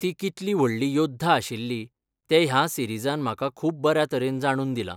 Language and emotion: Goan Konkani, neutral